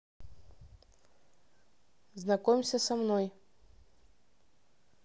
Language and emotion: Russian, neutral